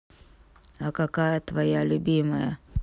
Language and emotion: Russian, neutral